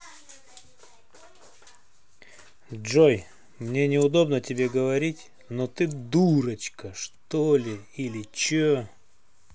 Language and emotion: Russian, angry